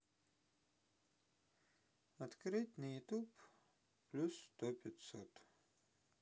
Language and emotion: Russian, neutral